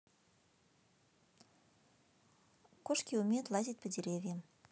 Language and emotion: Russian, neutral